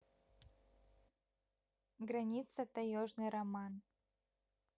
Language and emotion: Russian, neutral